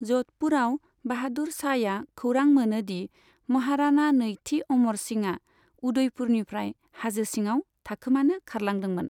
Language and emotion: Bodo, neutral